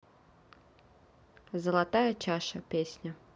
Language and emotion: Russian, neutral